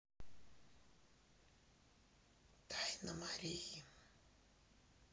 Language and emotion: Russian, neutral